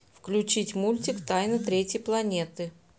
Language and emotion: Russian, neutral